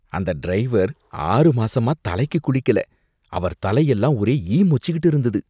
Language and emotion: Tamil, disgusted